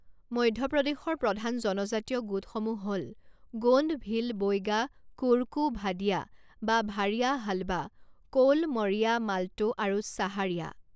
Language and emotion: Assamese, neutral